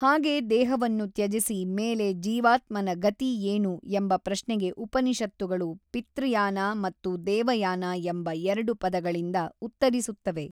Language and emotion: Kannada, neutral